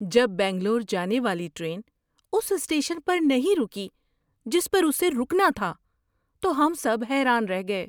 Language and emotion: Urdu, surprised